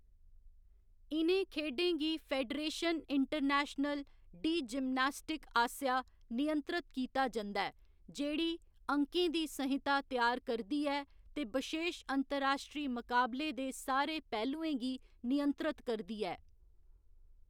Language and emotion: Dogri, neutral